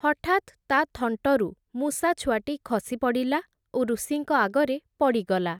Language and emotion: Odia, neutral